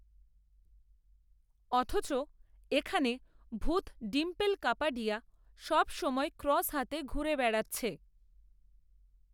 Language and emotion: Bengali, neutral